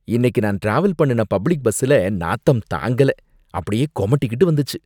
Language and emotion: Tamil, disgusted